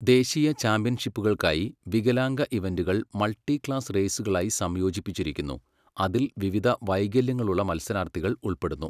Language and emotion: Malayalam, neutral